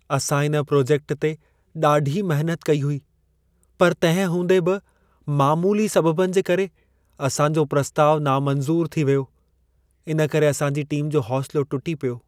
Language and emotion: Sindhi, sad